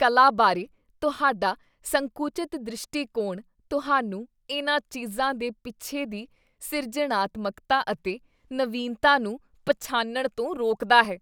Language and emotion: Punjabi, disgusted